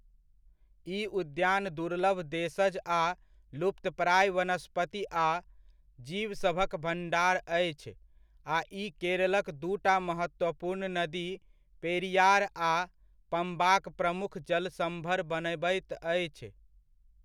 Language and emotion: Maithili, neutral